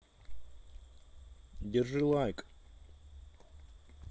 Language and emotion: Russian, neutral